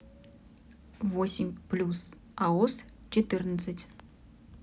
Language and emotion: Russian, neutral